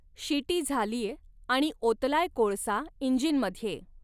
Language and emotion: Marathi, neutral